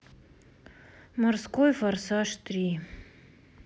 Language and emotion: Russian, sad